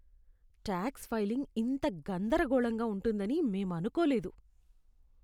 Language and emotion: Telugu, disgusted